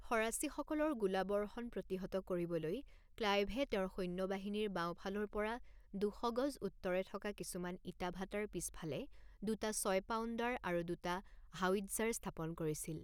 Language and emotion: Assamese, neutral